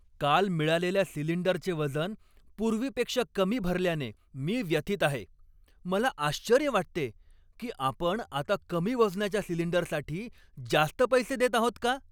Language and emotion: Marathi, angry